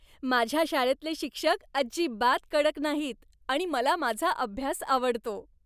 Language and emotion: Marathi, happy